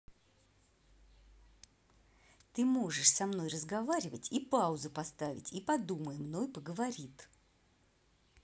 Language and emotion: Russian, angry